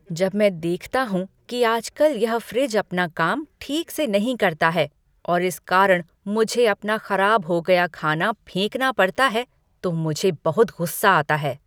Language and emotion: Hindi, angry